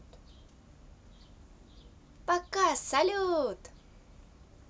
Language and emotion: Russian, positive